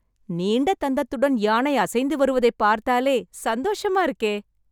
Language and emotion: Tamil, happy